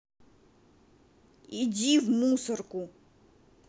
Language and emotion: Russian, angry